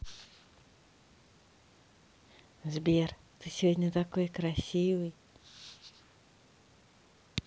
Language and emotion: Russian, positive